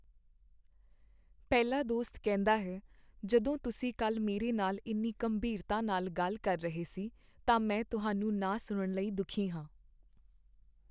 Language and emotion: Punjabi, sad